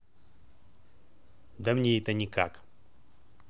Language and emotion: Russian, neutral